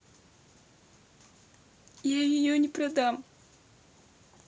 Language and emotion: Russian, sad